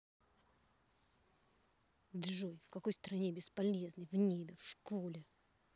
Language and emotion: Russian, angry